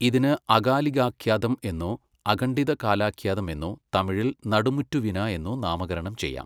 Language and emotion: Malayalam, neutral